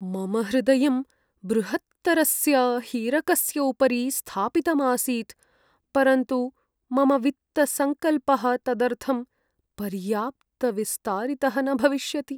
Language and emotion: Sanskrit, sad